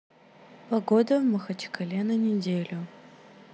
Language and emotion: Russian, neutral